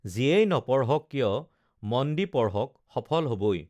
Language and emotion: Assamese, neutral